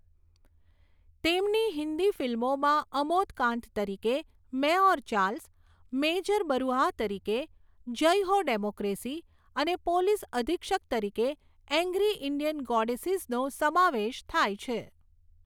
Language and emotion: Gujarati, neutral